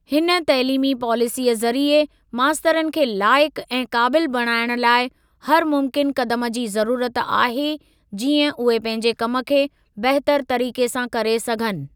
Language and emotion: Sindhi, neutral